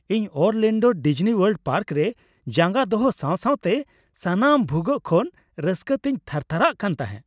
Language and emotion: Santali, happy